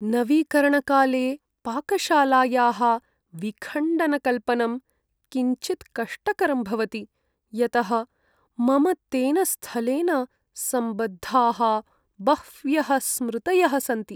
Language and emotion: Sanskrit, sad